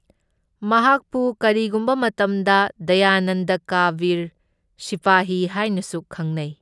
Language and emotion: Manipuri, neutral